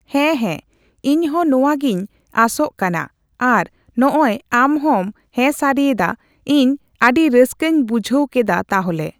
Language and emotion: Santali, neutral